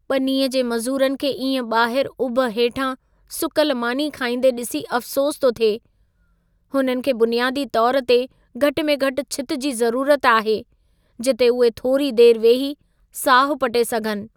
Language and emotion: Sindhi, sad